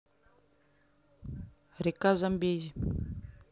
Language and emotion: Russian, neutral